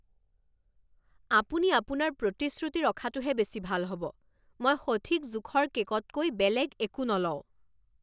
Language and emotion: Assamese, angry